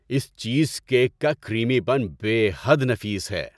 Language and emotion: Urdu, happy